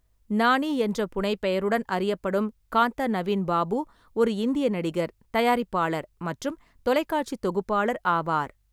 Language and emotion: Tamil, neutral